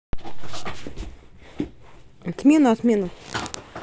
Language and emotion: Russian, neutral